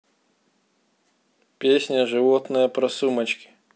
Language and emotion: Russian, neutral